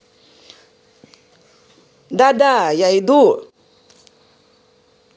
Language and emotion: Russian, positive